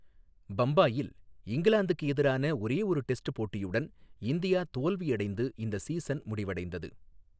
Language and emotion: Tamil, neutral